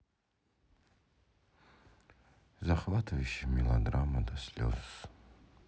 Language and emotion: Russian, sad